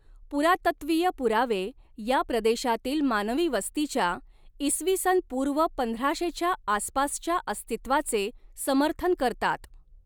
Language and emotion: Marathi, neutral